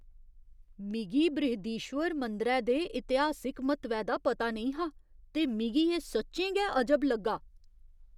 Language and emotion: Dogri, surprised